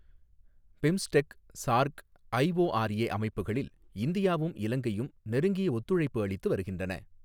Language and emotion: Tamil, neutral